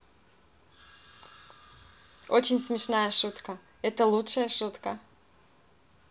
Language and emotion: Russian, positive